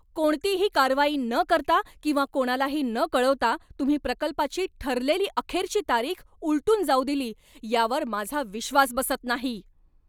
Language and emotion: Marathi, angry